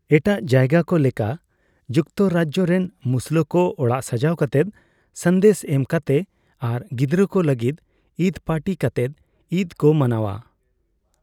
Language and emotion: Santali, neutral